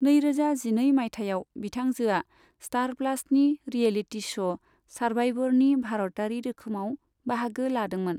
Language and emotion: Bodo, neutral